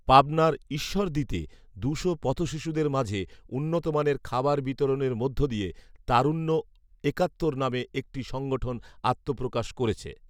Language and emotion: Bengali, neutral